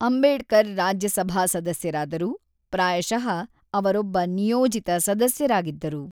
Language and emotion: Kannada, neutral